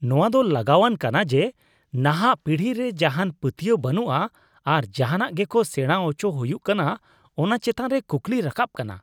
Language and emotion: Santali, disgusted